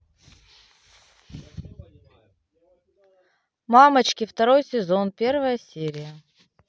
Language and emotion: Russian, neutral